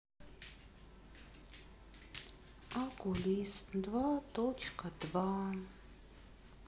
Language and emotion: Russian, sad